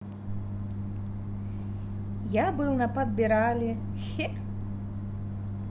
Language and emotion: Russian, positive